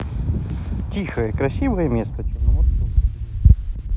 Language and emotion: Russian, positive